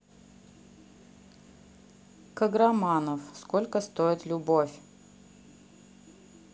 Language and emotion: Russian, neutral